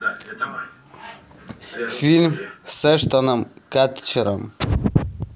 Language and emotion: Russian, neutral